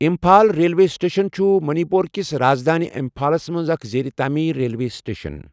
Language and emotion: Kashmiri, neutral